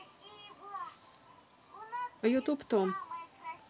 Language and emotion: Russian, neutral